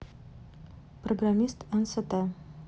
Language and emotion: Russian, neutral